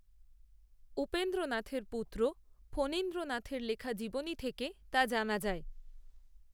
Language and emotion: Bengali, neutral